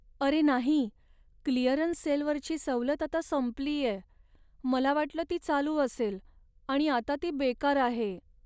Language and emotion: Marathi, sad